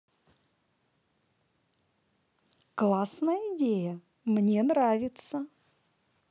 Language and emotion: Russian, positive